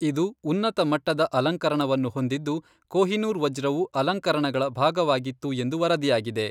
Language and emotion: Kannada, neutral